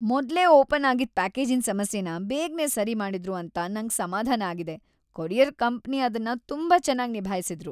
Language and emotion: Kannada, happy